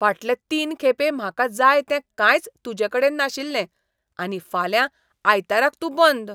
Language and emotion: Goan Konkani, disgusted